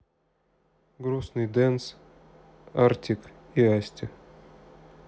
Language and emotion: Russian, sad